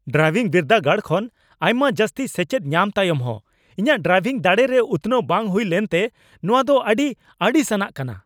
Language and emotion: Santali, angry